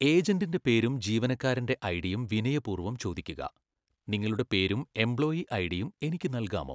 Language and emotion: Malayalam, neutral